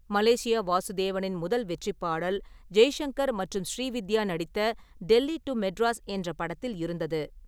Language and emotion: Tamil, neutral